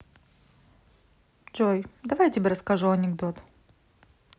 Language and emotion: Russian, neutral